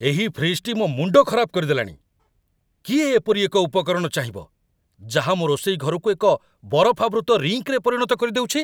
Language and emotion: Odia, angry